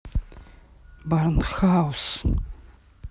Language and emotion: Russian, neutral